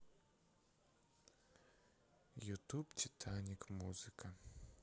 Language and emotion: Russian, sad